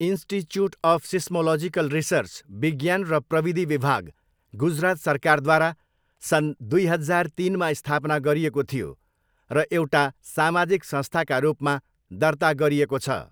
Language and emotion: Nepali, neutral